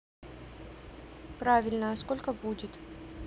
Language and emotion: Russian, neutral